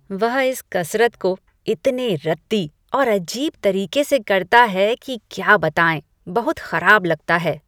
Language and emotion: Hindi, disgusted